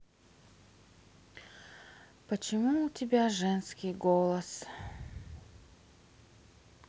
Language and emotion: Russian, sad